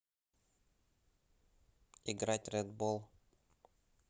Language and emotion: Russian, neutral